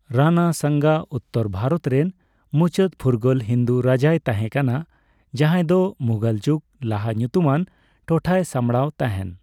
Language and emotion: Santali, neutral